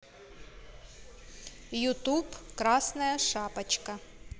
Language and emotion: Russian, neutral